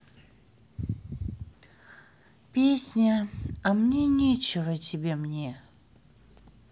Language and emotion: Russian, sad